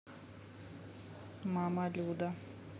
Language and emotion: Russian, neutral